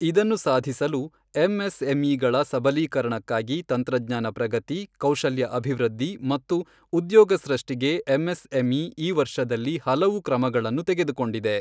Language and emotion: Kannada, neutral